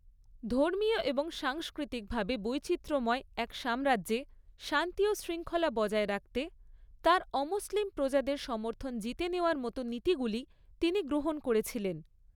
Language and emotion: Bengali, neutral